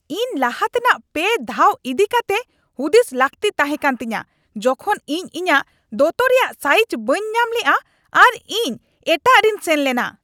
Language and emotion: Santali, angry